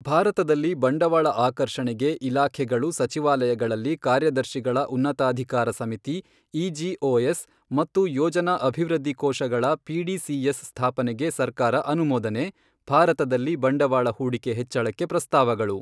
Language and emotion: Kannada, neutral